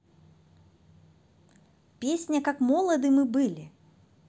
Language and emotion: Russian, positive